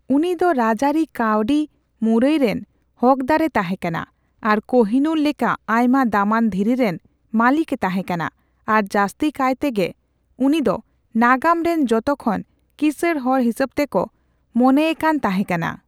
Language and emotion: Santali, neutral